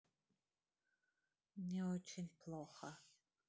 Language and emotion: Russian, sad